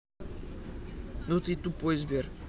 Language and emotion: Russian, angry